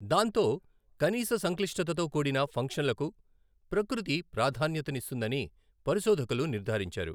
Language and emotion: Telugu, neutral